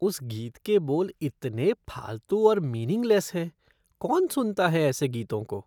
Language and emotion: Hindi, disgusted